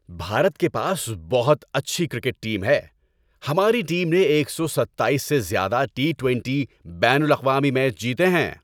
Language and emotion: Urdu, happy